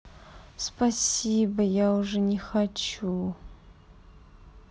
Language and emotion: Russian, sad